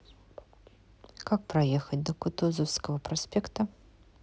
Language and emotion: Russian, neutral